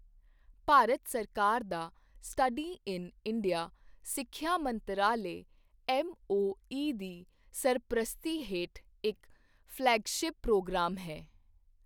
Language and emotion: Punjabi, neutral